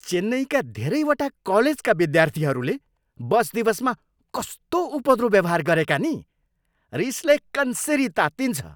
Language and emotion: Nepali, angry